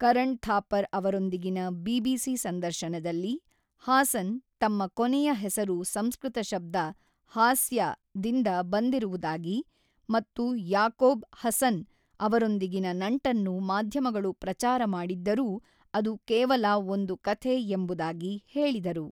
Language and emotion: Kannada, neutral